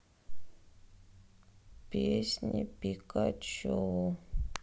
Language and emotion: Russian, sad